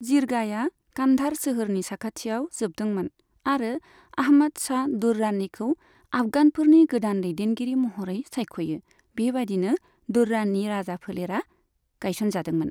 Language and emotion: Bodo, neutral